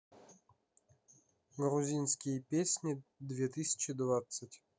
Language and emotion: Russian, neutral